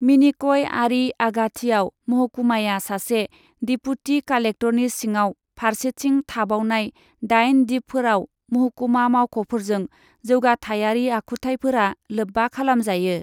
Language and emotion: Bodo, neutral